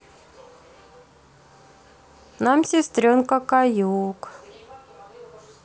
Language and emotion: Russian, neutral